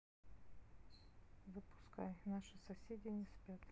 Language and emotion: Russian, neutral